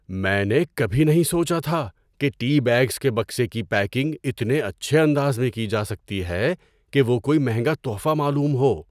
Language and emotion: Urdu, surprised